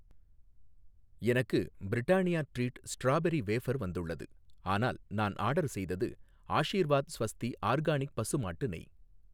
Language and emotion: Tamil, neutral